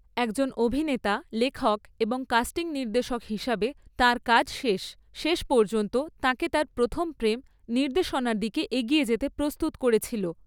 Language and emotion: Bengali, neutral